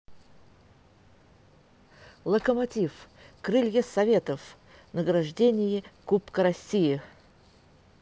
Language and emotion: Russian, positive